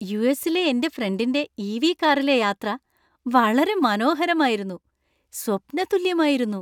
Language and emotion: Malayalam, happy